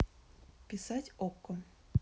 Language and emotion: Russian, neutral